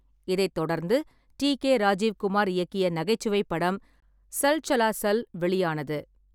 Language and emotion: Tamil, neutral